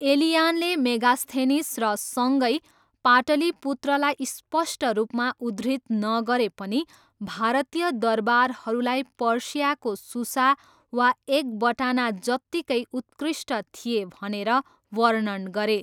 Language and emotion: Nepali, neutral